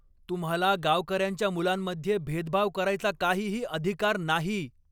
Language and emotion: Marathi, angry